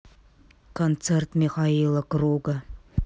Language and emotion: Russian, neutral